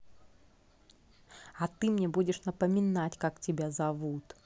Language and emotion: Russian, angry